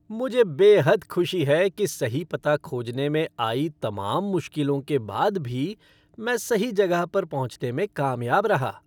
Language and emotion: Hindi, happy